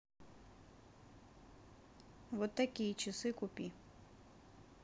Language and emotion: Russian, neutral